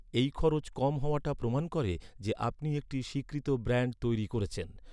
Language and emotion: Bengali, neutral